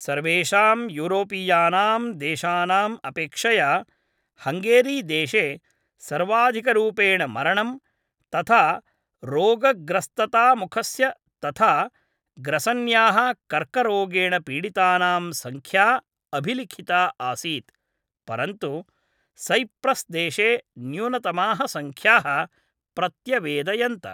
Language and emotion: Sanskrit, neutral